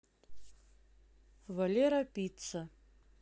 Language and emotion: Russian, neutral